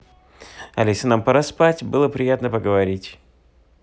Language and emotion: Russian, positive